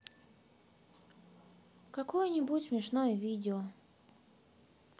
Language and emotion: Russian, sad